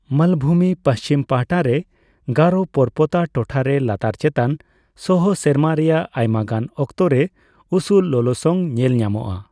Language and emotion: Santali, neutral